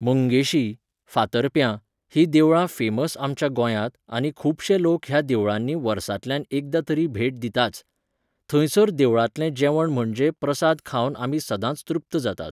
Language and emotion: Goan Konkani, neutral